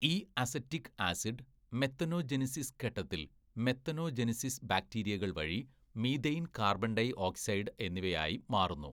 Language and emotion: Malayalam, neutral